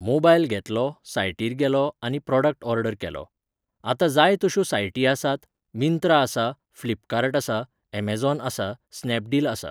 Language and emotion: Goan Konkani, neutral